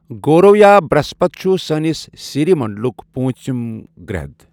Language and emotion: Kashmiri, neutral